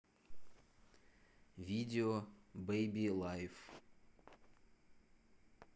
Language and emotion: Russian, neutral